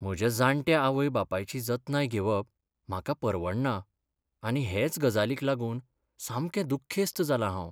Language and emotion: Goan Konkani, sad